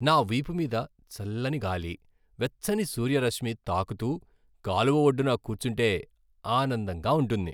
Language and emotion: Telugu, happy